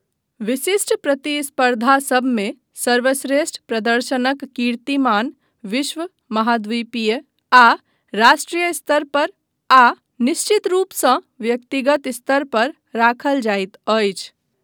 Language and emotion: Maithili, neutral